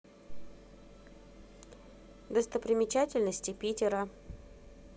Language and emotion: Russian, neutral